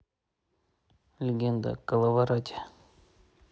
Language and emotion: Russian, neutral